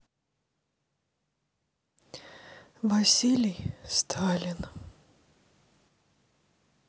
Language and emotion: Russian, sad